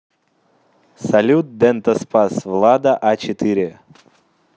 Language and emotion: Russian, positive